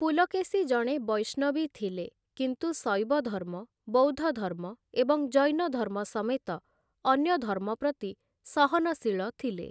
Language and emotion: Odia, neutral